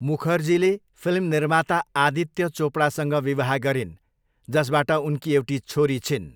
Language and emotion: Nepali, neutral